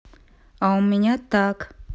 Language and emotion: Russian, neutral